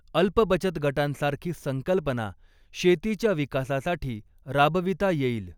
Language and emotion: Marathi, neutral